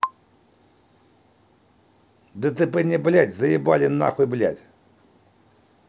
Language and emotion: Russian, angry